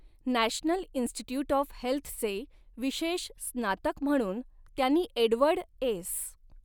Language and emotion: Marathi, neutral